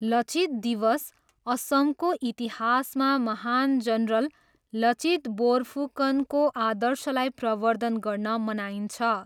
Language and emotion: Nepali, neutral